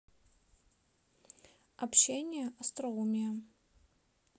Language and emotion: Russian, neutral